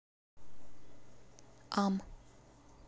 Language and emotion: Russian, neutral